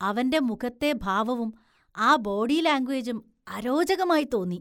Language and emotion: Malayalam, disgusted